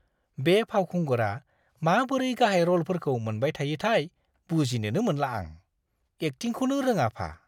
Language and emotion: Bodo, disgusted